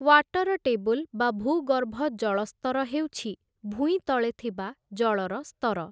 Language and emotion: Odia, neutral